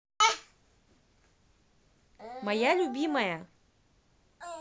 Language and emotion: Russian, positive